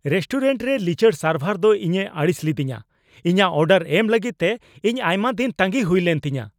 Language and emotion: Santali, angry